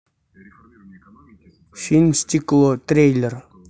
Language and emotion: Russian, neutral